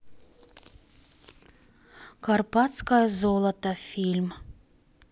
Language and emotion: Russian, neutral